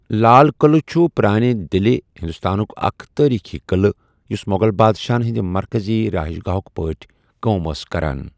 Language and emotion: Kashmiri, neutral